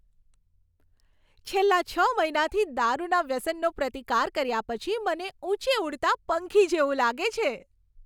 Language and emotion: Gujarati, happy